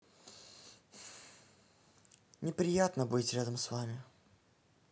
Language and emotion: Russian, sad